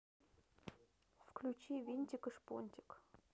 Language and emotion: Russian, neutral